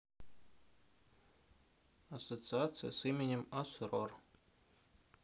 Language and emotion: Russian, neutral